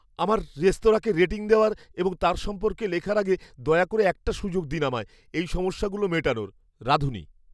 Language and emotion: Bengali, fearful